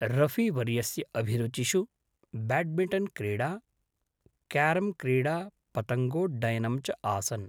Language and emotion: Sanskrit, neutral